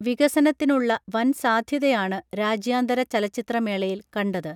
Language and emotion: Malayalam, neutral